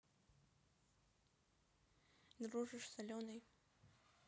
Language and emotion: Russian, neutral